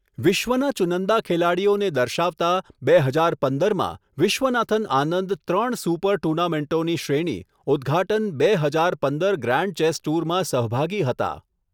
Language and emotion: Gujarati, neutral